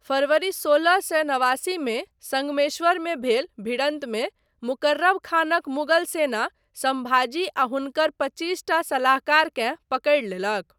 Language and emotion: Maithili, neutral